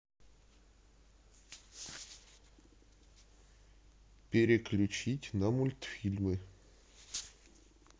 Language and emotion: Russian, neutral